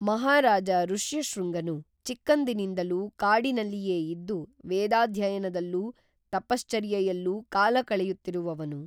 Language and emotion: Kannada, neutral